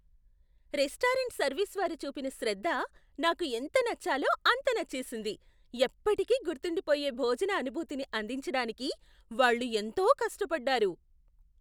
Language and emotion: Telugu, surprised